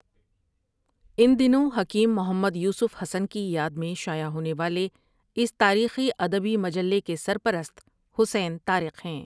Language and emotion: Urdu, neutral